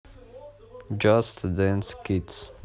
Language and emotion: Russian, neutral